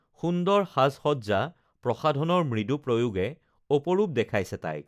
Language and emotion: Assamese, neutral